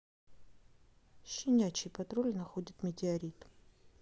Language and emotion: Russian, neutral